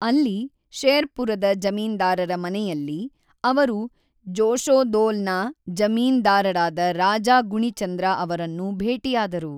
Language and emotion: Kannada, neutral